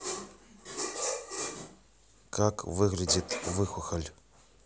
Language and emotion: Russian, neutral